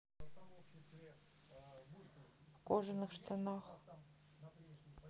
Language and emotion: Russian, neutral